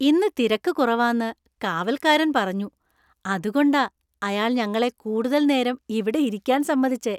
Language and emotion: Malayalam, happy